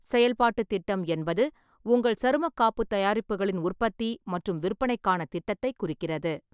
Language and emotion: Tamil, neutral